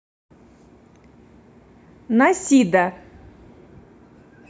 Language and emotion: Russian, neutral